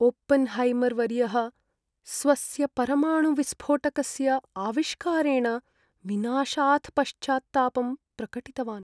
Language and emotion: Sanskrit, sad